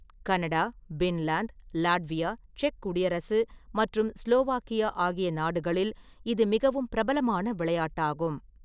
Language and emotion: Tamil, neutral